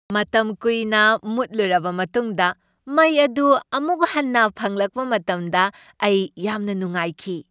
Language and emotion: Manipuri, happy